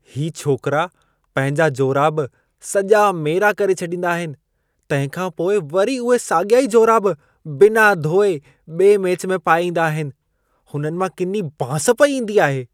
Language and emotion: Sindhi, disgusted